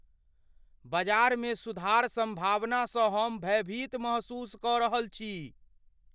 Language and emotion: Maithili, fearful